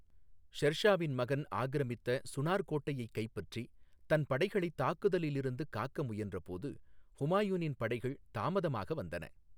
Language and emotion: Tamil, neutral